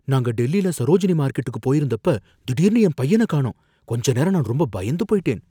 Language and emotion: Tamil, fearful